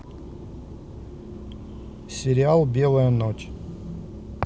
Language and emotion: Russian, neutral